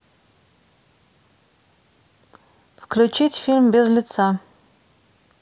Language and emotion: Russian, neutral